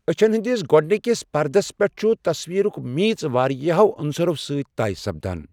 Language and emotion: Kashmiri, neutral